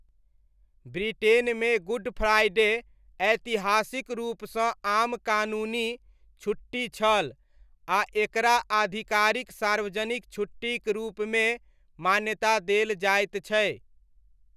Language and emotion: Maithili, neutral